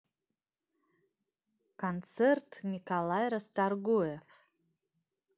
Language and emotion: Russian, neutral